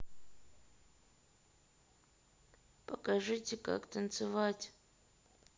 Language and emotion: Russian, sad